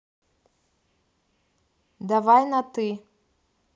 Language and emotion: Russian, neutral